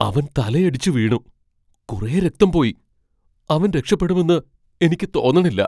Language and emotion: Malayalam, fearful